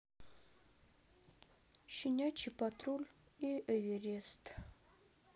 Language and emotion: Russian, sad